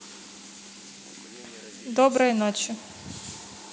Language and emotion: Russian, neutral